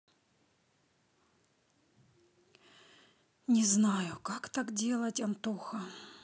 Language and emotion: Russian, sad